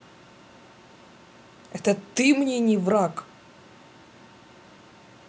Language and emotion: Russian, angry